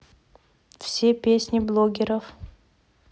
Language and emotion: Russian, neutral